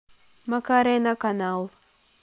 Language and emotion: Russian, neutral